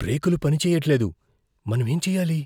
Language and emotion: Telugu, fearful